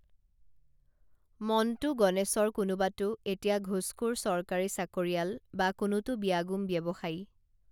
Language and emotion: Assamese, neutral